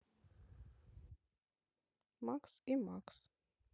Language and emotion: Russian, neutral